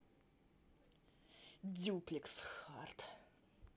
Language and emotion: Russian, angry